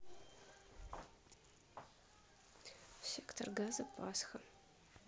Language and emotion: Russian, neutral